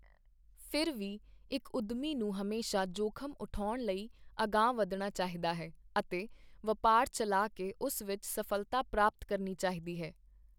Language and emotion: Punjabi, neutral